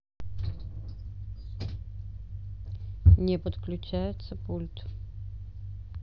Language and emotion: Russian, neutral